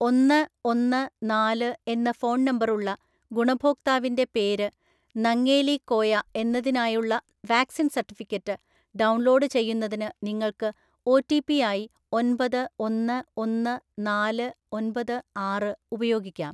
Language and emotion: Malayalam, neutral